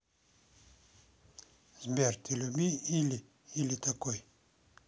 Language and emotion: Russian, neutral